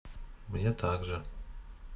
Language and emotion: Russian, neutral